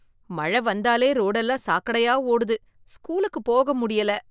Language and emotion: Tamil, disgusted